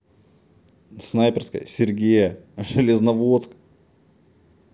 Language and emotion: Russian, neutral